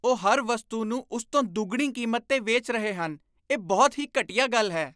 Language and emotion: Punjabi, disgusted